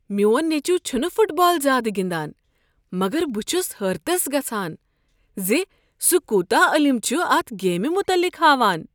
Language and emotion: Kashmiri, surprised